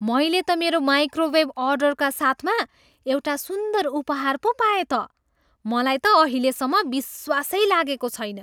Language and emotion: Nepali, surprised